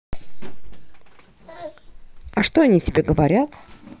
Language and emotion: Russian, neutral